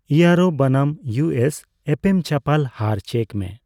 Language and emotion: Santali, neutral